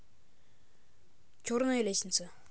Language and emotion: Russian, neutral